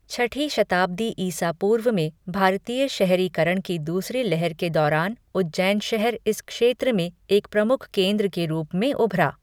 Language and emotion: Hindi, neutral